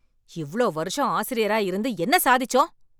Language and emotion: Tamil, angry